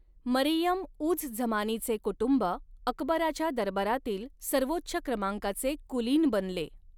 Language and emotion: Marathi, neutral